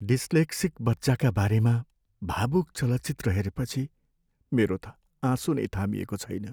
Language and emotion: Nepali, sad